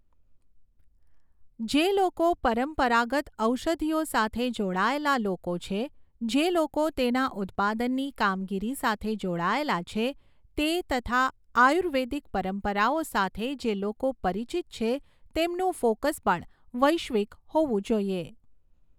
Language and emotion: Gujarati, neutral